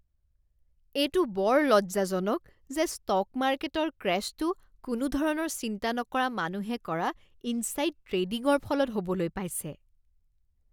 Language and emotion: Assamese, disgusted